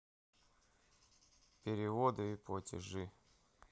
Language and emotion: Russian, neutral